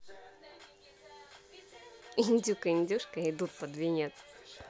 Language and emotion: Russian, positive